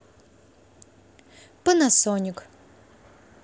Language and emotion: Russian, neutral